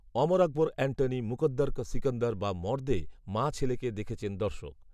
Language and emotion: Bengali, neutral